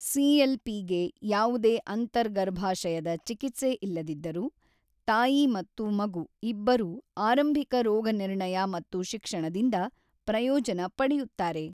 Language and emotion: Kannada, neutral